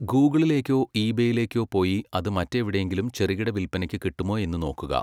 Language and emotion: Malayalam, neutral